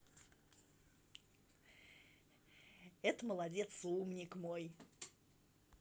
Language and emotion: Russian, positive